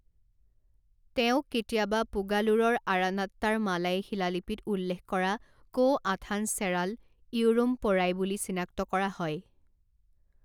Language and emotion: Assamese, neutral